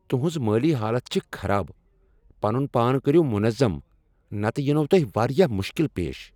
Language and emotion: Kashmiri, angry